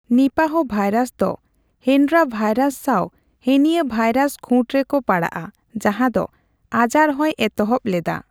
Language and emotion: Santali, neutral